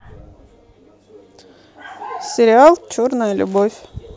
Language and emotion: Russian, neutral